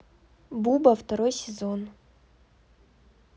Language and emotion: Russian, neutral